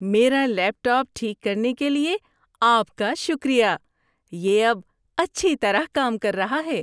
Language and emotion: Urdu, happy